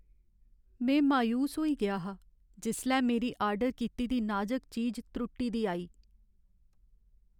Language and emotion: Dogri, sad